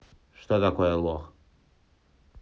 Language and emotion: Russian, neutral